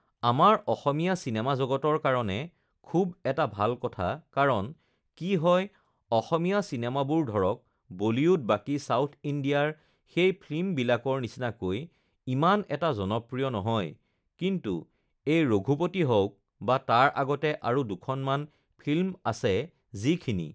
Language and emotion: Assamese, neutral